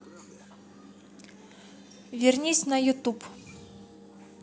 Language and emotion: Russian, neutral